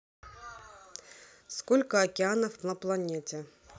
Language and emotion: Russian, neutral